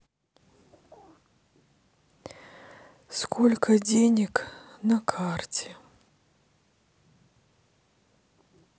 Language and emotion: Russian, sad